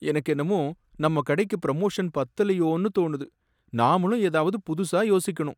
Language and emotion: Tamil, sad